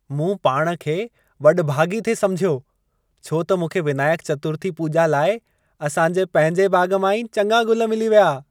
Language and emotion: Sindhi, happy